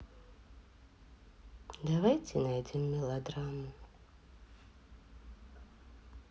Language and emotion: Russian, sad